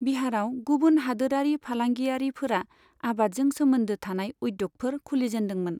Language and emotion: Bodo, neutral